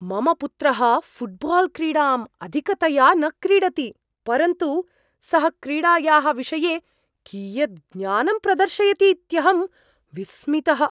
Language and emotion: Sanskrit, surprised